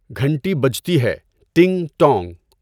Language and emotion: Urdu, neutral